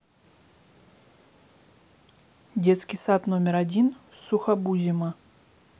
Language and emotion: Russian, neutral